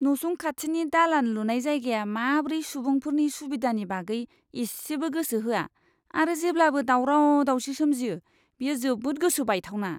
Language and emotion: Bodo, disgusted